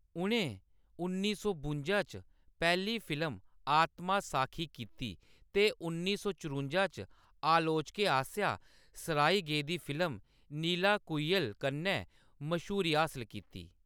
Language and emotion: Dogri, neutral